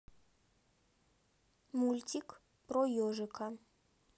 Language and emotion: Russian, neutral